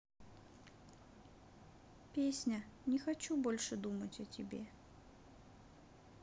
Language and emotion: Russian, sad